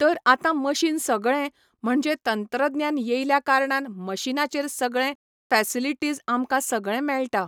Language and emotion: Goan Konkani, neutral